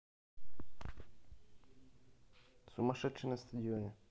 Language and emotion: Russian, neutral